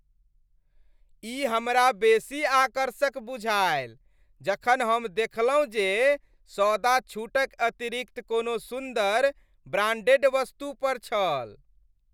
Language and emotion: Maithili, happy